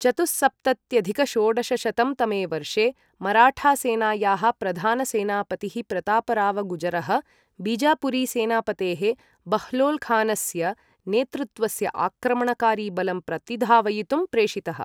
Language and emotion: Sanskrit, neutral